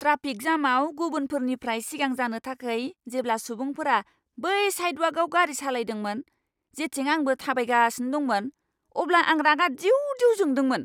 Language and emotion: Bodo, angry